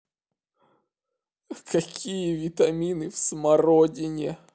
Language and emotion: Russian, sad